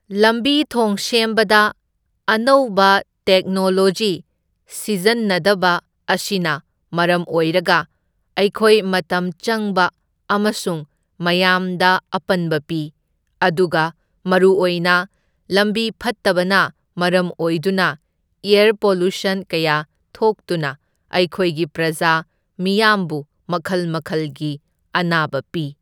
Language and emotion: Manipuri, neutral